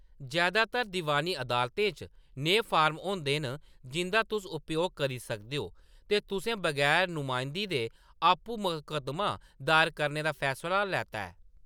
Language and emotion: Dogri, neutral